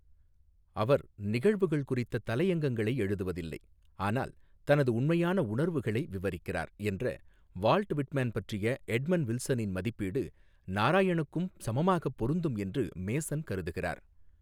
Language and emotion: Tamil, neutral